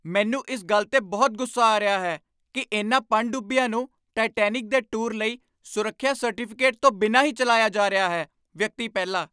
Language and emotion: Punjabi, angry